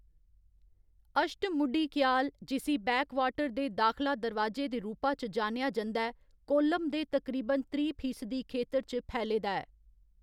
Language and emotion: Dogri, neutral